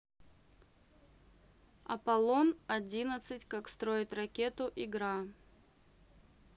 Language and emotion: Russian, neutral